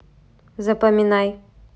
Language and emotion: Russian, neutral